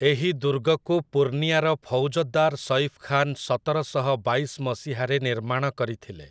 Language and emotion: Odia, neutral